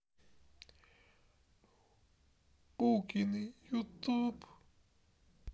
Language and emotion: Russian, sad